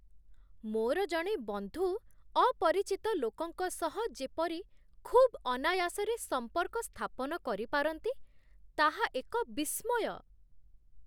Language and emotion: Odia, surprised